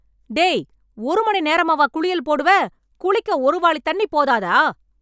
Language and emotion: Tamil, angry